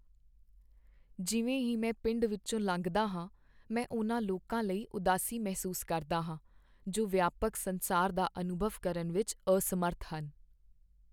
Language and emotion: Punjabi, sad